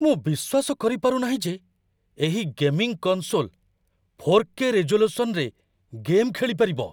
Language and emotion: Odia, surprised